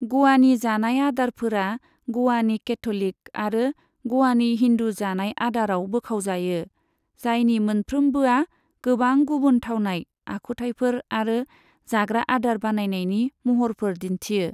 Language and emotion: Bodo, neutral